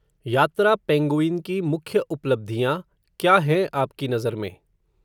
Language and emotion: Hindi, neutral